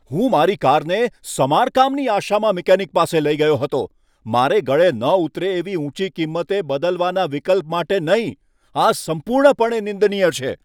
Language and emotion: Gujarati, angry